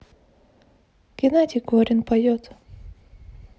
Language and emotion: Russian, neutral